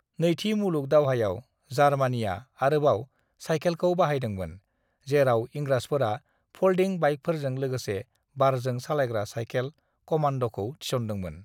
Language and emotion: Bodo, neutral